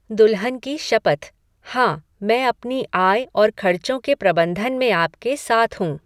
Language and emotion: Hindi, neutral